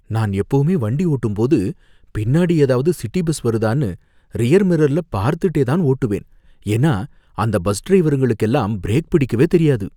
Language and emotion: Tamil, fearful